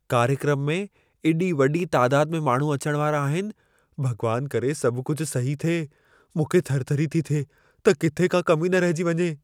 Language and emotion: Sindhi, fearful